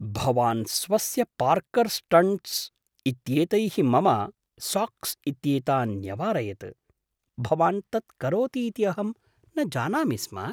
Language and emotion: Sanskrit, surprised